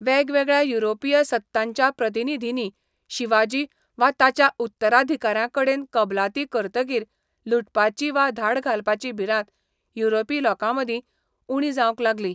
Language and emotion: Goan Konkani, neutral